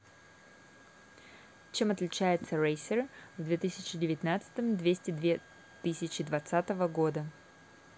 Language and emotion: Russian, neutral